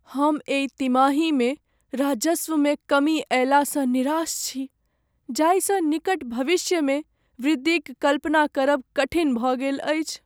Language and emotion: Maithili, sad